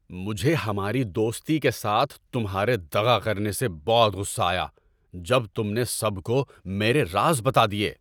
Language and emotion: Urdu, angry